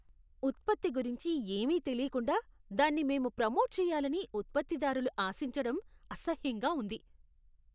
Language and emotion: Telugu, disgusted